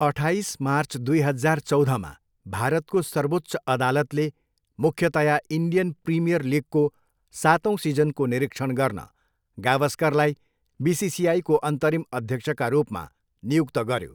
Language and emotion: Nepali, neutral